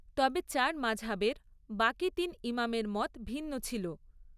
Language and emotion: Bengali, neutral